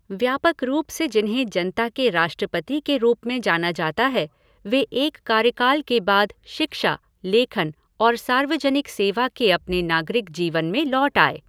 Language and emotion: Hindi, neutral